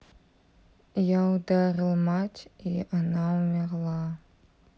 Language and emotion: Russian, sad